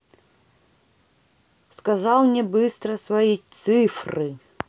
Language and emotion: Russian, neutral